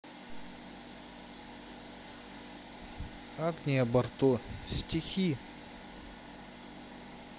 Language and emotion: Russian, neutral